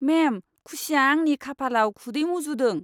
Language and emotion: Bodo, disgusted